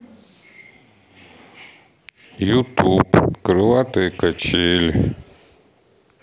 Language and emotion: Russian, sad